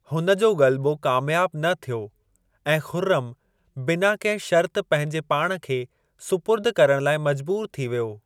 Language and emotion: Sindhi, neutral